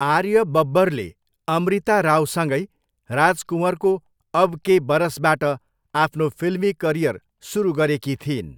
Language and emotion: Nepali, neutral